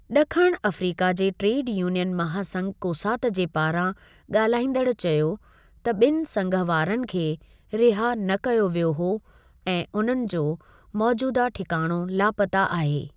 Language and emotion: Sindhi, neutral